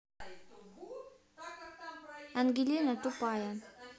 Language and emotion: Russian, neutral